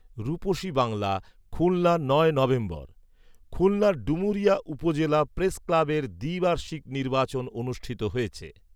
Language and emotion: Bengali, neutral